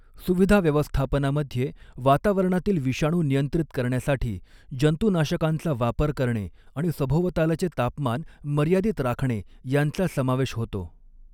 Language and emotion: Marathi, neutral